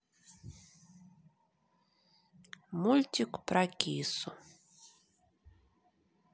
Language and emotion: Russian, neutral